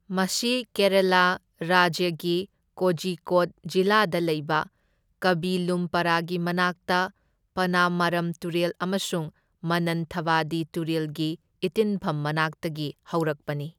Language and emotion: Manipuri, neutral